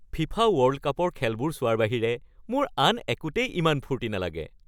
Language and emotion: Assamese, happy